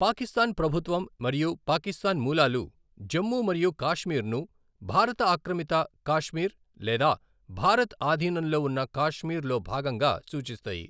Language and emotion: Telugu, neutral